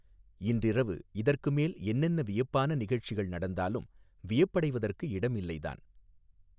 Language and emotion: Tamil, neutral